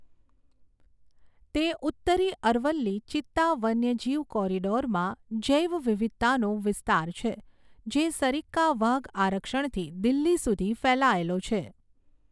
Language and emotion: Gujarati, neutral